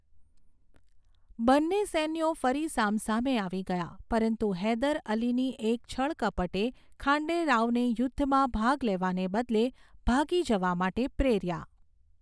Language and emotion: Gujarati, neutral